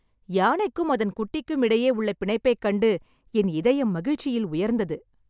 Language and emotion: Tamil, happy